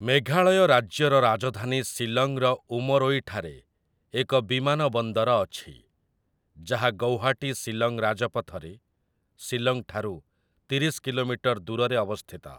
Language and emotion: Odia, neutral